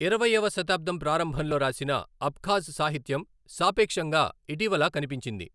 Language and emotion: Telugu, neutral